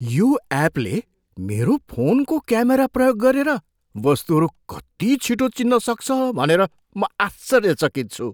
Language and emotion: Nepali, surprised